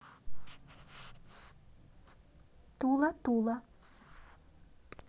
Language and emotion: Russian, neutral